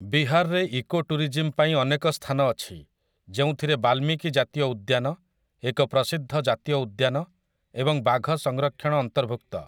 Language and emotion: Odia, neutral